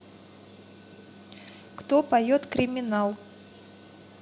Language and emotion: Russian, neutral